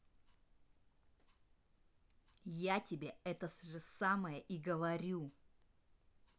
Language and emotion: Russian, angry